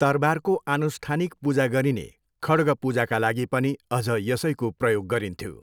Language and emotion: Nepali, neutral